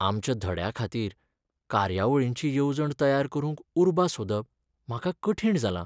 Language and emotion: Goan Konkani, sad